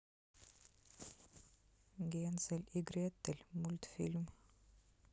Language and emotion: Russian, neutral